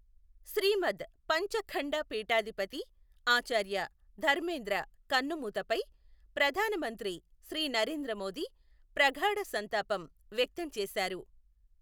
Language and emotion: Telugu, neutral